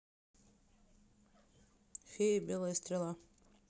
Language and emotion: Russian, neutral